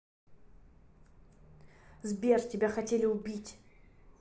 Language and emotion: Russian, angry